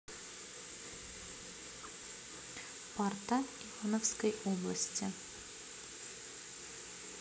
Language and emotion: Russian, neutral